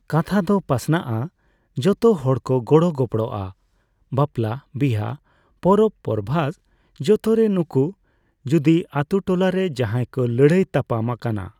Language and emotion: Santali, neutral